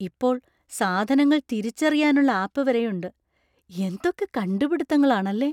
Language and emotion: Malayalam, surprised